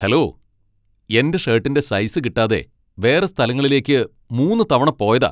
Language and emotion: Malayalam, angry